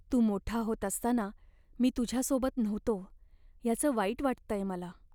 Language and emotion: Marathi, sad